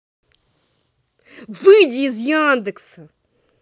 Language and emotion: Russian, angry